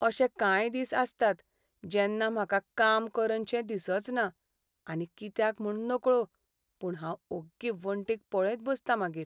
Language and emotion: Goan Konkani, sad